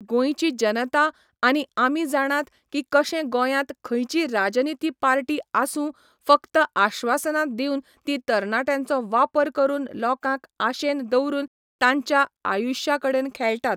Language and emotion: Goan Konkani, neutral